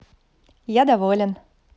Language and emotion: Russian, positive